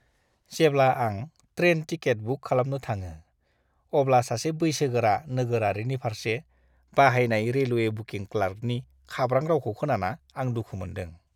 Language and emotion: Bodo, disgusted